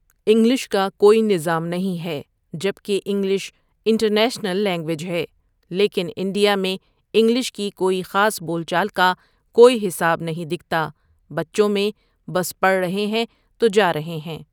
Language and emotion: Urdu, neutral